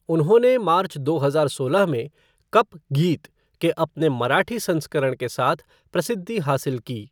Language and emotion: Hindi, neutral